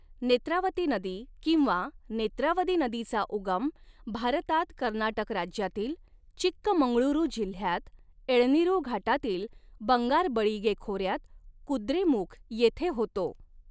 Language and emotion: Marathi, neutral